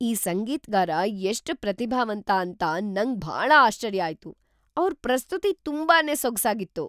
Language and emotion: Kannada, surprised